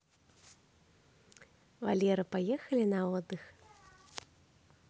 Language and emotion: Russian, positive